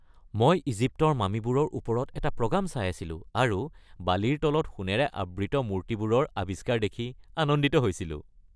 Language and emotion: Assamese, happy